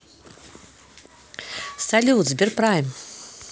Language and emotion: Russian, positive